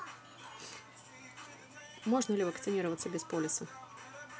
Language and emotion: Russian, neutral